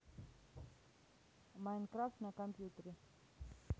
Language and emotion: Russian, neutral